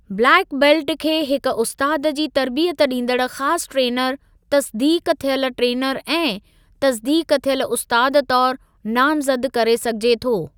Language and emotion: Sindhi, neutral